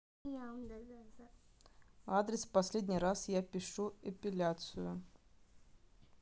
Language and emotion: Russian, neutral